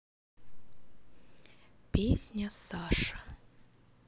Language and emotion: Russian, neutral